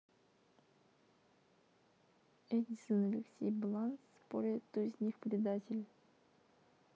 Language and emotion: Russian, neutral